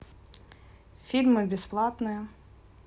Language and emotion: Russian, neutral